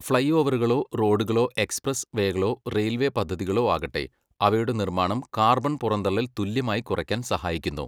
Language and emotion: Malayalam, neutral